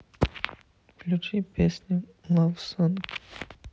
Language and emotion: Russian, sad